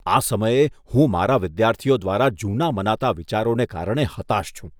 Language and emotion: Gujarati, disgusted